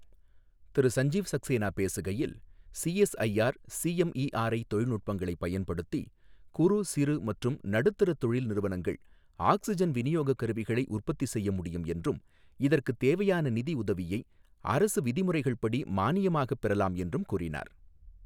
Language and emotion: Tamil, neutral